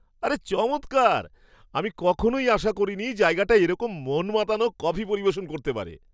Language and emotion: Bengali, surprised